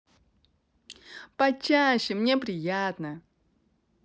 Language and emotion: Russian, positive